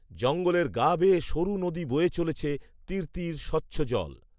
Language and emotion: Bengali, neutral